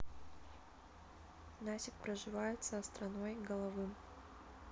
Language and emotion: Russian, neutral